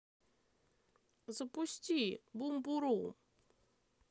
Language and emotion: Russian, neutral